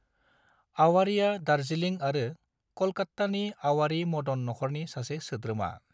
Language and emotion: Bodo, neutral